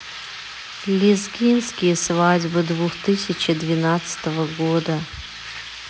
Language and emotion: Russian, neutral